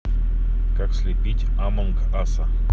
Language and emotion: Russian, neutral